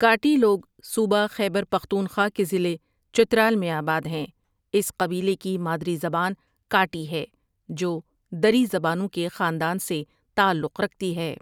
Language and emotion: Urdu, neutral